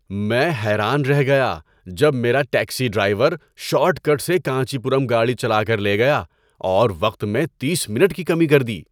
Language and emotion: Urdu, surprised